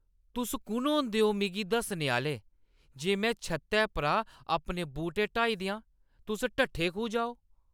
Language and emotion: Dogri, angry